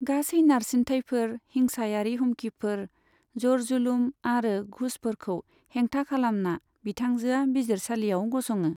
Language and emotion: Bodo, neutral